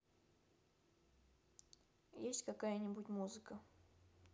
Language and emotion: Russian, neutral